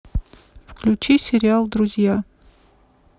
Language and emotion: Russian, neutral